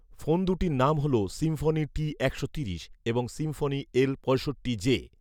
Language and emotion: Bengali, neutral